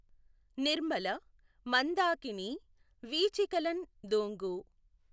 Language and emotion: Telugu, neutral